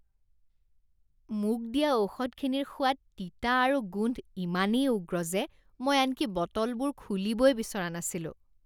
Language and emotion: Assamese, disgusted